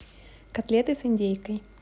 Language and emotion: Russian, neutral